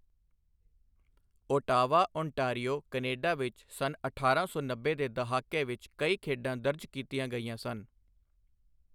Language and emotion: Punjabi, neutral